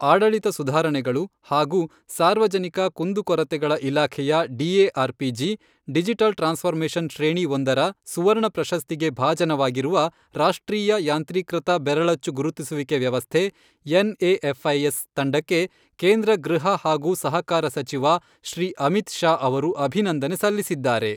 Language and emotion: Kannada, neutral